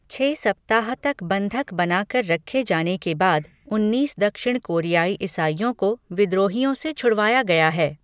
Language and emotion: Hindi, neutral